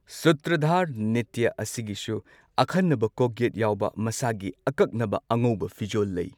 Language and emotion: Manipuri, neutral